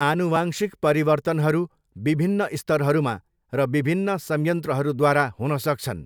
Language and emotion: Nepali, neutral